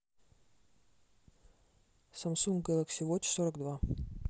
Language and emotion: Russian, neutral